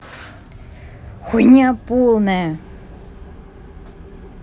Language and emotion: Russian, angry